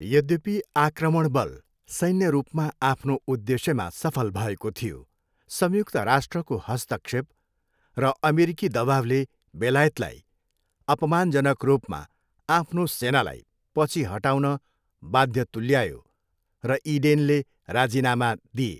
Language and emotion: Nepali, neutral